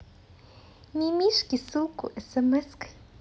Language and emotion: Russian, positive